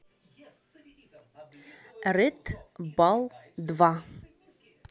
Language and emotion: Russian, neutral